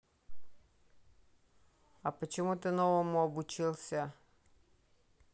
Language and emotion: Russian, neutral